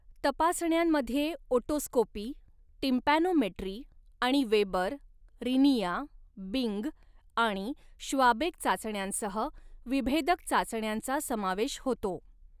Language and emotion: Marathi, neutral